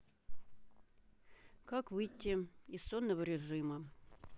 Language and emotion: Russian, neutral